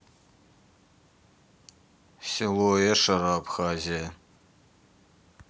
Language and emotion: Russian, neutral